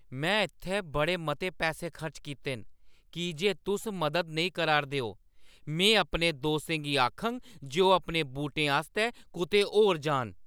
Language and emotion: Dogri, angry